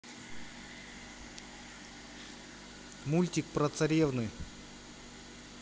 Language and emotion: Russian, neutral